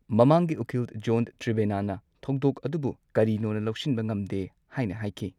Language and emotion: Manipuri, neutral